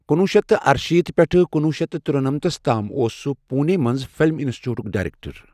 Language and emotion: Kashmiri, neutral